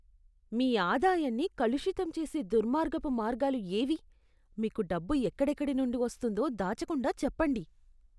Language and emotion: Telugu, disgusted